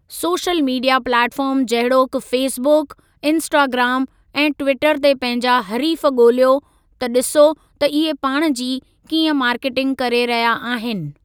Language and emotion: Sindhi, neutral